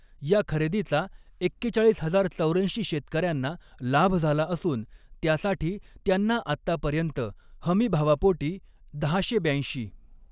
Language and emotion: Marathi, neutral